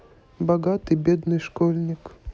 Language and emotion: Russian, neutral